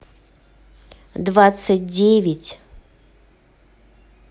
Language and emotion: Russian, neutral